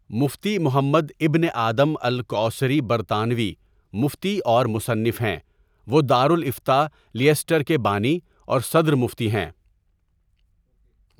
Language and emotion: Urdu, neutral